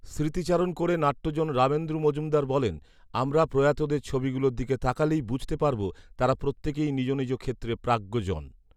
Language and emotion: Bengali, neutral